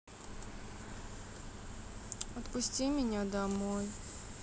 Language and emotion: Russian, sad